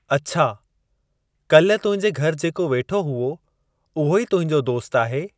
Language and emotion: Sindhi, neutral